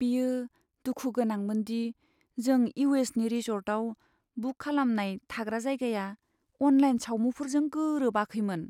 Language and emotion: Bodo, sad